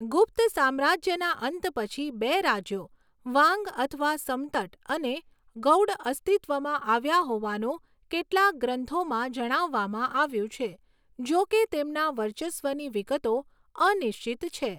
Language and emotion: Gujarati, neutral